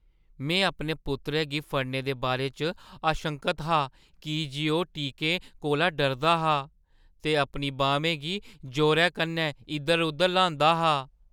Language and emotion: Dogri, fearful